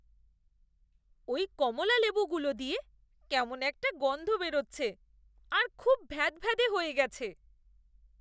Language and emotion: Bengali, disgusted